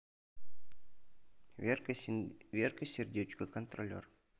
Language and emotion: Russian, neutral